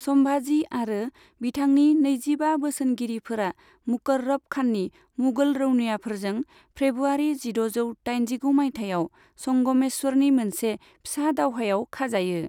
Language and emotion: Bodo, neutral